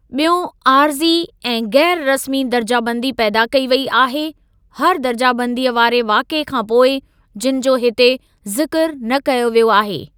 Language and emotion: Sindhi, neutral